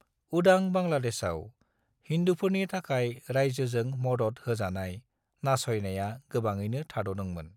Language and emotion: Bodo, neutral